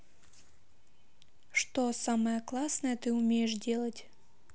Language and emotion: Russian, neutral